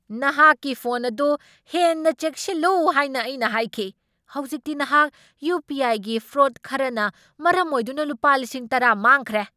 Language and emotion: Manipuri, angry